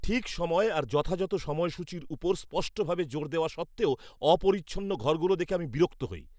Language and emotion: Bengali, angry